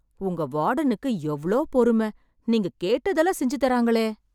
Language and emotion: Tamil, surprised